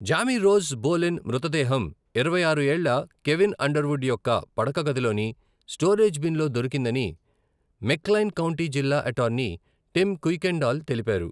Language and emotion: Telugu, neutral